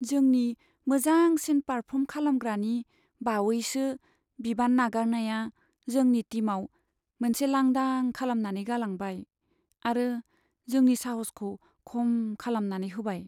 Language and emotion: Bodo, sad